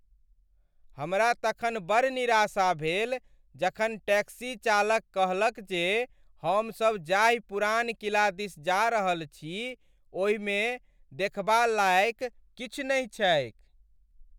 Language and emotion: Maithili, sad